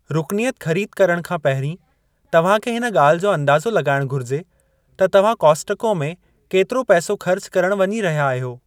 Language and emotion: Sindhi, neutral